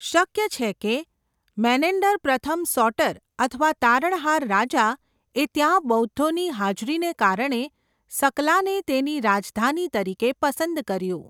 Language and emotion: Gujarati, neutral